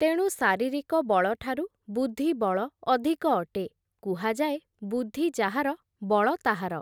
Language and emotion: Odia, neutral